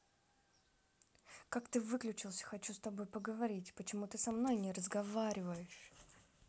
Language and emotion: Russian, angry